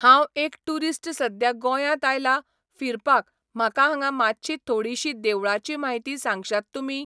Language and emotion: Goan Konkani, neutral